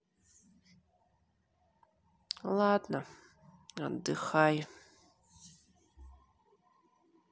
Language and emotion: Russian, sad